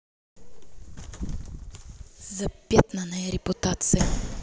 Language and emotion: Russian, angry